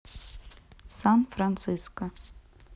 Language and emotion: Russian, neutral